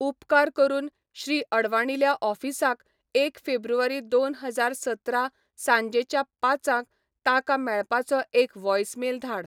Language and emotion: Goan Konkani, neutral